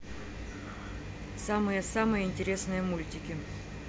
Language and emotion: Russian, neutral